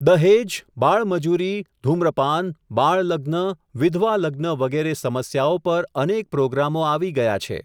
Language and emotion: Gujarati, neutral